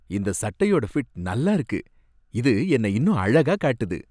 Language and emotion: Tamil, happy